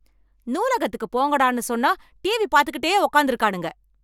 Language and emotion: Tamil, angry